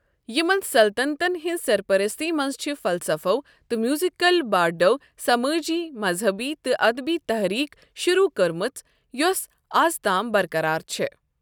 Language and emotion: Kashmiri, neutral